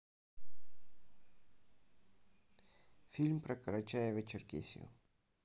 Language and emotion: Russian, neutral